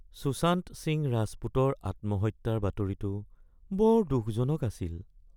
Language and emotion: Assamese, sad